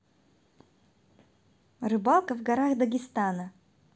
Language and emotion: Russian, positive